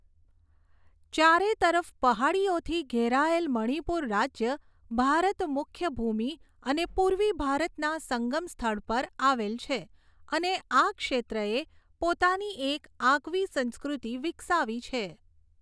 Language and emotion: Gujarati, neutral